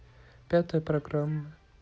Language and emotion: Russian, neutral